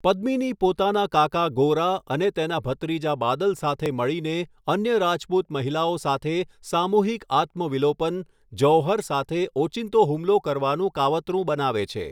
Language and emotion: Gujarati, neutral